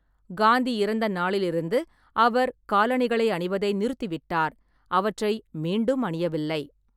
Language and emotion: Tamil, neutral